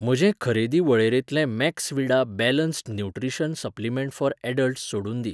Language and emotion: Goan Konkani, neutral